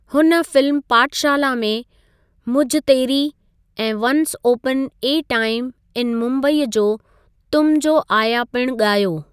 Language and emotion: Sindhi, neutral